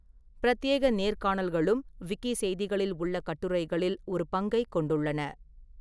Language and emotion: Tamil, neutral